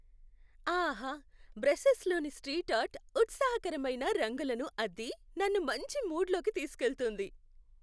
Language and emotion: Telugu, happy